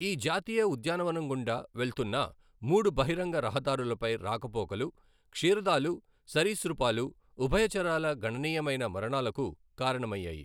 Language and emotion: Telugu, neutral